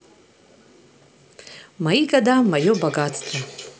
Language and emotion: Russian, positive